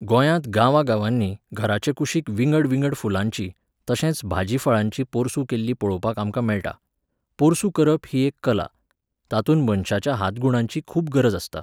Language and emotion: Goan Konkani, neutral